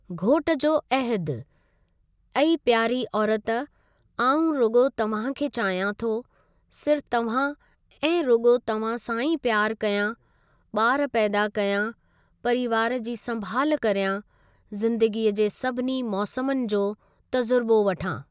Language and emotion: Sindhi, neutral